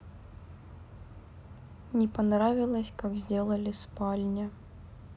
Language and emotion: Russian, sad